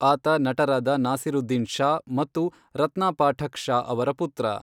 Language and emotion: Kannada, neutral